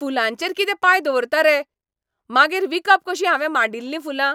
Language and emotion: Goan Konkani, angry